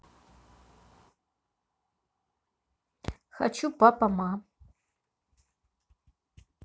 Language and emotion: Russian, neutral